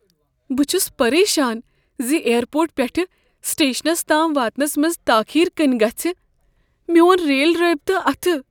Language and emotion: Kashmiri, fearful